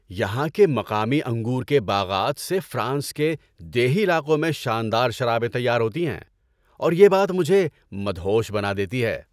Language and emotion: Urdu, happy